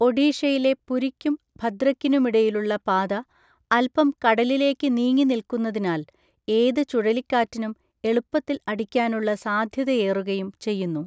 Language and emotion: Malayalam, neutral